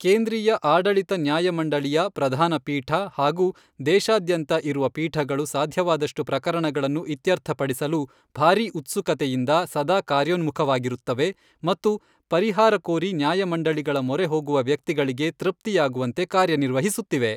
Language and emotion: Kannada, neutral